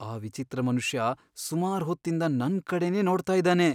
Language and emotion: Kannada, fearful